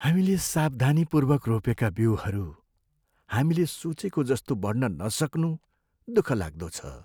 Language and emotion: Nepali, sad